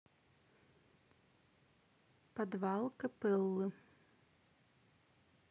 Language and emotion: Russian, neutral